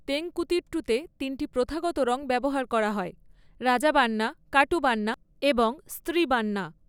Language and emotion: Bengali, neutral